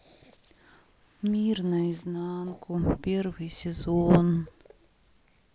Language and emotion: Russian, sad